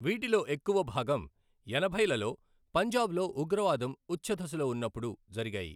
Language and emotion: Telugu, neutral